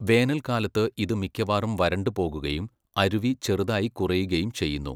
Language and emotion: Malayalam, neutral